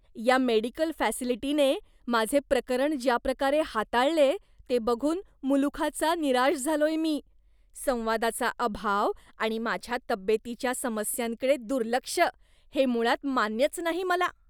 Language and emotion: Marathi, disgusted